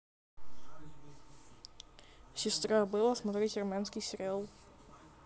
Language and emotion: Russian, neutral